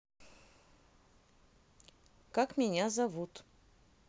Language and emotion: Russian, neutral